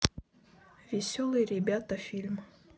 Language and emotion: Russian, neutral